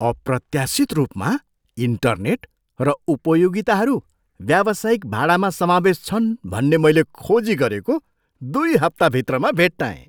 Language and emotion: Nepali, surprised